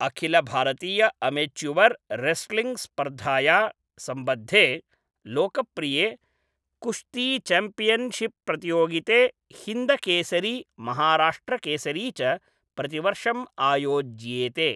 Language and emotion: Sanskrit, neutral